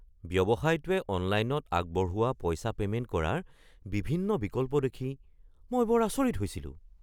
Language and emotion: Assamese, surprised